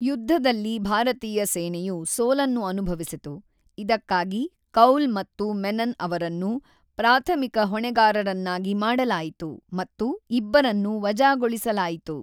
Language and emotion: Kannada, neutral